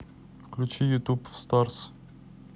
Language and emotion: Russian, neutral